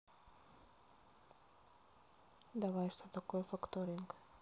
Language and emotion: Russian, neutral